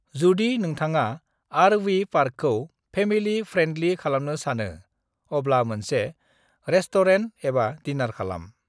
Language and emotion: Bodo, neutral